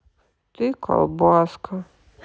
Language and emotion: Russian, sad